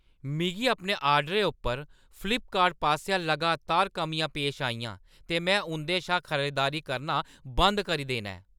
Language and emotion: Dogri, angry